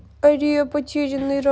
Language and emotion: Russian, sad